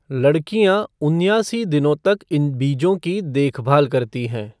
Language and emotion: Hindi, neutral